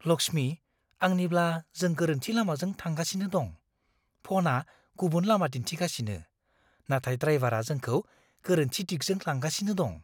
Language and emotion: Bodo, fearful